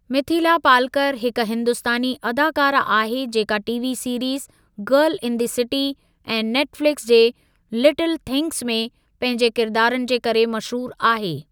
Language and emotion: Sindhi, neutral